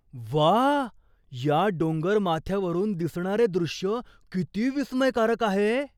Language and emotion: Marathi, surprised